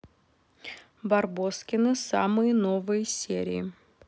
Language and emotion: Russian, neutral